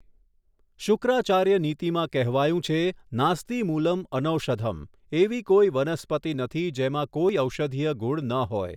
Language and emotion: Gujarati, neutral